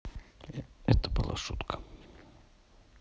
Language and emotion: Russian, neutral